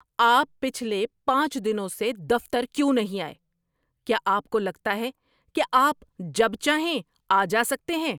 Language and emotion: Urdu, angry